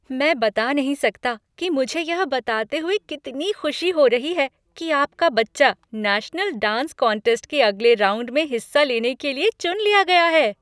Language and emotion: Hindi, happy